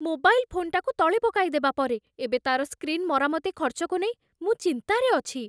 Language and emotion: Odia, fearful